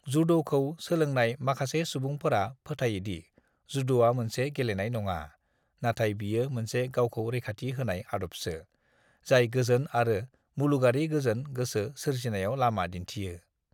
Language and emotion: Bodo, neutral